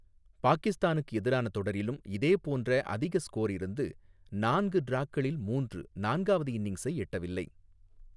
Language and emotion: Tamil, neutral